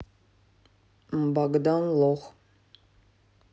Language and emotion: Russian, neutral